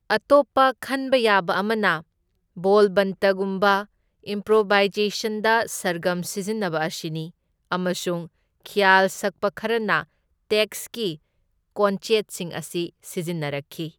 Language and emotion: Manipuri, neutral